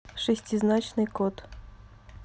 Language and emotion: Russian, neutral